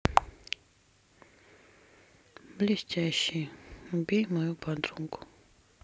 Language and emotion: Russian, sad